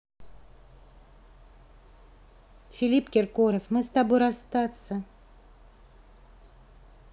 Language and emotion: Russian, neutral